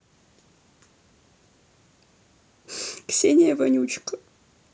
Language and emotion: Russian, sad